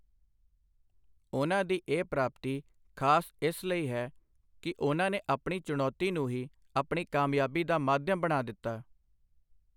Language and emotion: Punjabi, neutral